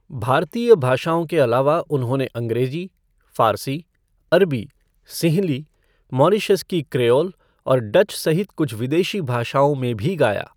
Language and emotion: Hindi, neutral